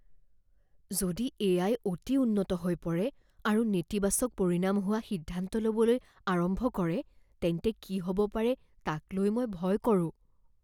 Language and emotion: Assamese, fearful